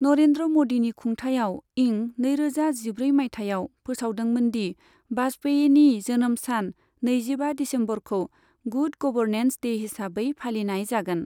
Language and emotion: Bodo, neutral